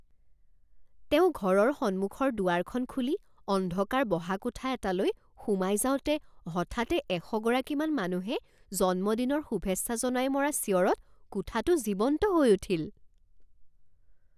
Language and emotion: Assamese, surprised